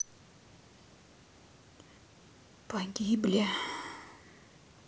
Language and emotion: Russian, sad